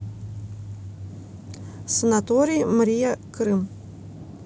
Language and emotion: Russian, neutral